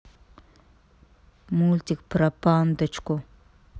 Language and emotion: Russian, neutral